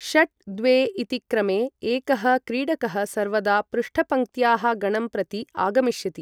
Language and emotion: Sanskrit, neutral